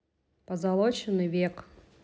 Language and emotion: Russian, neutral